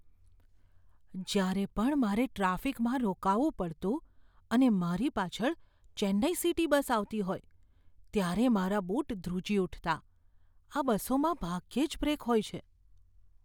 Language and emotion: Gujarati, fearful